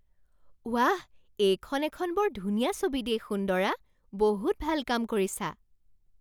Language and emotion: Assamese, surprised